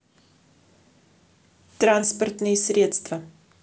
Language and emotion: Russian, neutral